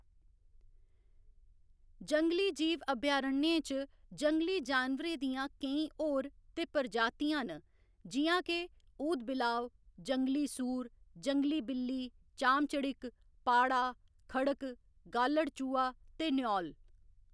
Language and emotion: Dogri, neutral